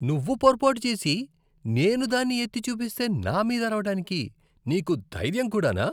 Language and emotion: Telugu, disgusted